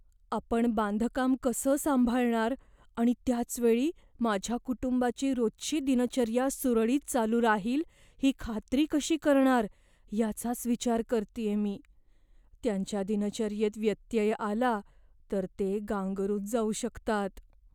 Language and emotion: Marathi, fearful